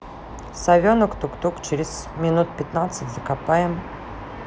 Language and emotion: Russian, neutral